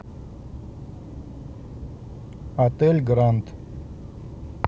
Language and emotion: Russian, neutral